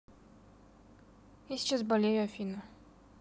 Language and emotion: Russian, neutral